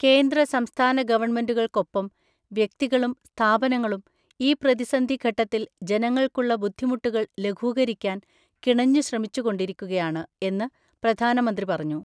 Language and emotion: Malayalam, neutral